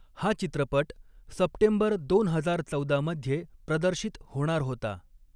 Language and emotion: Marathi, neutral